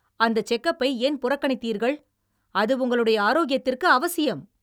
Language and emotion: Tamil, angry